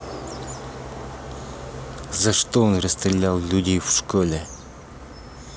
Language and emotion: Russian, angry